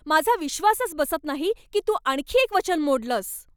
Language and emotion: Marathi, angry